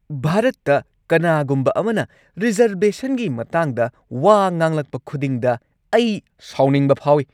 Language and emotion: Manipuri, angry